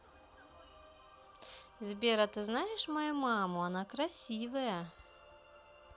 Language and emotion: Russian, positive